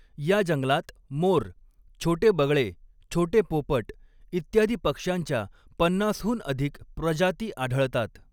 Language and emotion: Marathi, neutral